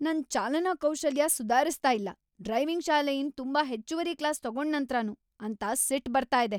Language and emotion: Kannada, angry